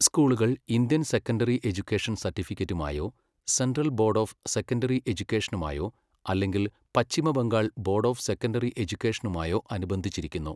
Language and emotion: Malayalam, neutral